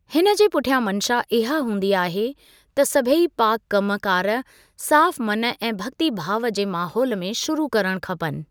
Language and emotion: Sindhi, neutral